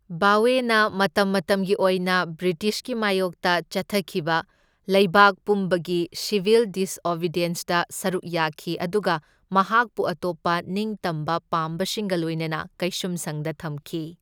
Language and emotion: Manipuri, neutral